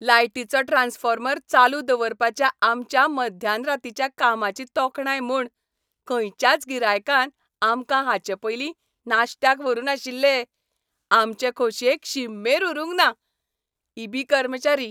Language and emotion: Goan Konkani, happy